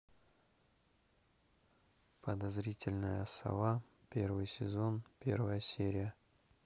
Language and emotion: Russian, neutral